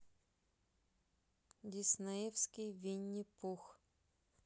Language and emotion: Russian, neutral